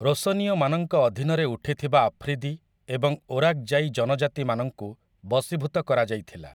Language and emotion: Odia, neutral